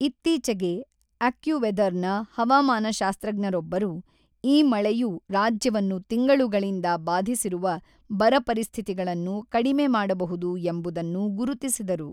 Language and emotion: Kannada, neutral